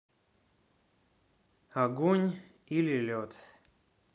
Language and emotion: Russian, neutral